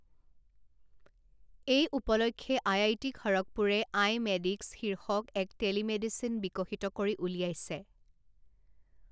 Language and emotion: Assamese, neutral